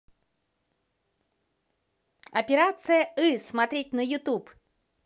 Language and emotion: Russian, positive